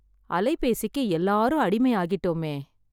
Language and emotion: Tamil, sad